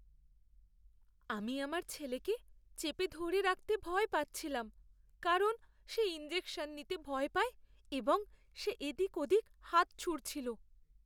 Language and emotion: Bengali, fearful